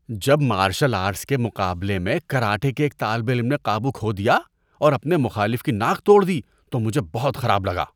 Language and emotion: Urdu, disgusted